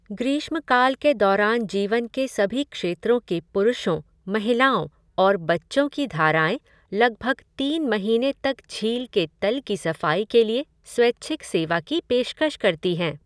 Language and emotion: Hindi, neutral